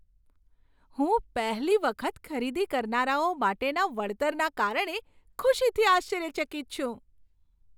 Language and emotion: Gujarati, surprised